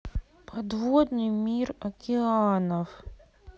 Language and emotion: Russian, sad